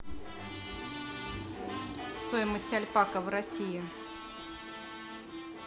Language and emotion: Russian, neutral